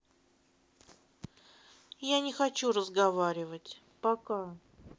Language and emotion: Russian, sad